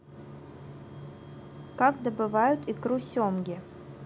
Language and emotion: Russian, neutral